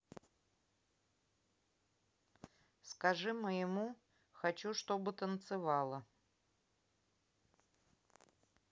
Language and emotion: Russian, neutral